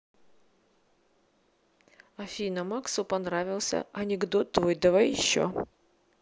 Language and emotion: Russian, neutral